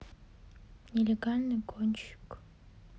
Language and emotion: Russian, sad